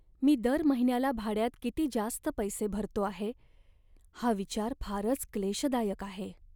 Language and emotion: Marathi, sad